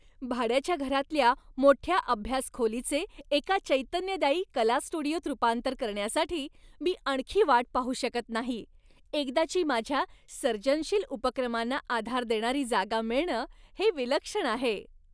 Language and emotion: Marathi, happy